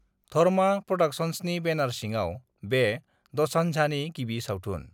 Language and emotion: Bodo, neutral